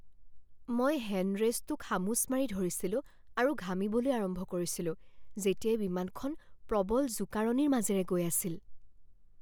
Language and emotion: Assamese, fearful